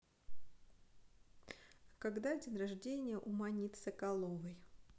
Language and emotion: Russian, neutral